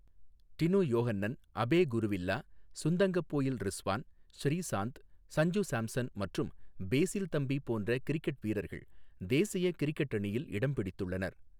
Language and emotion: Tamil, neutral